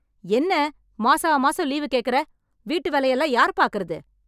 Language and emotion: Tamil, angry